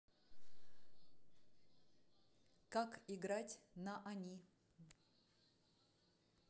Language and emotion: Russian, neutral